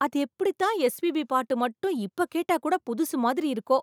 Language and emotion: Tamil, surprised